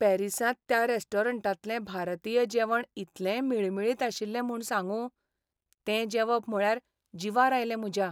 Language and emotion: Goan Konkani, sad